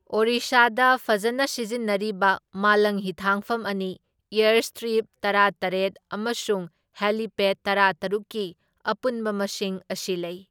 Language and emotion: Manipuri, neutral